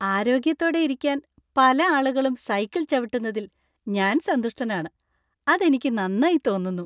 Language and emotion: Malayalam, happy